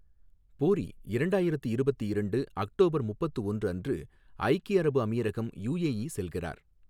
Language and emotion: Tamil, neutral